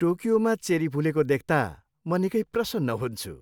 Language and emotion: Nepali, happy